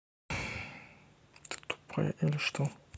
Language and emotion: Russian, neutral